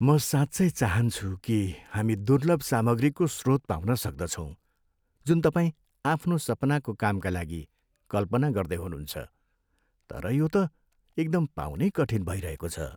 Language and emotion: Nepali, sad